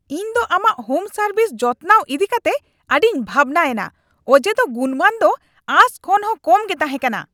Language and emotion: Santali, angry